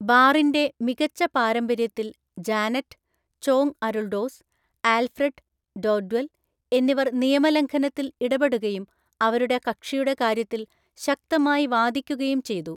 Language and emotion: Malayalam, neutral